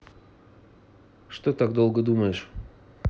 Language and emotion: Russian, neutral